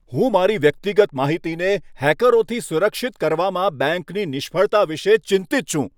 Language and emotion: Gujarati, angry